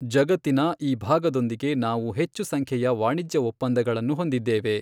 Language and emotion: Kannada, neutral